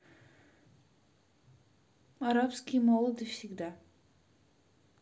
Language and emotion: Russian, neutral